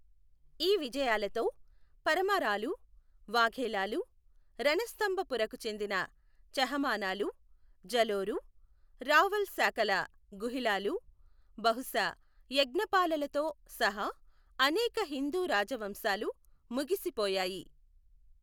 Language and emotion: Telugu, neutral